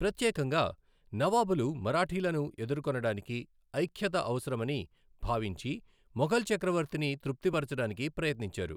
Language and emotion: Telugu, neutral